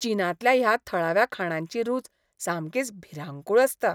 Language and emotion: Goan Konkani, disgusted